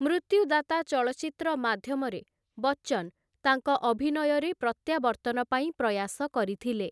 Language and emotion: Odia, neutral